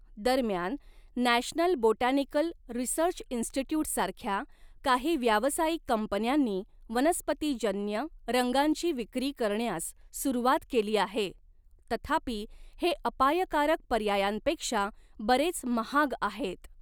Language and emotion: Marathi, neutral